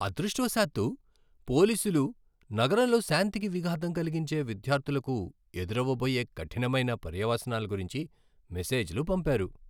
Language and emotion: Telugu, happy